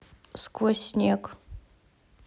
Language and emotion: Russian, neutral